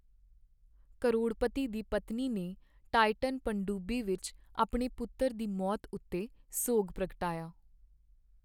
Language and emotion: Punjabi, sad